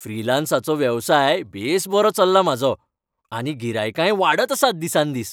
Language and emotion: Goan Konkani, happy